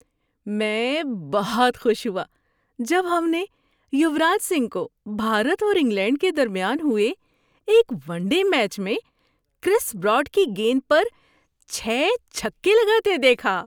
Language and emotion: Urdu, happy